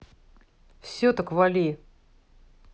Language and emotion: Russian, angry